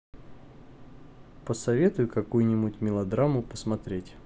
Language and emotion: Russian, neutral